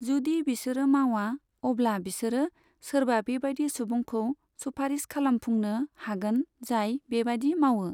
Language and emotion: Bodo, neutral